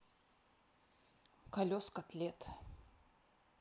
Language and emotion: Russian, neutral